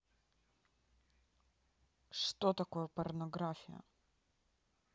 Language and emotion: Russian, neutral